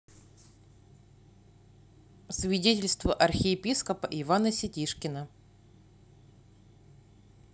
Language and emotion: Russian, neutral